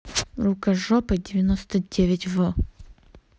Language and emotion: Russian, angry